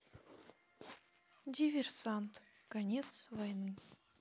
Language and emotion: Russian, sad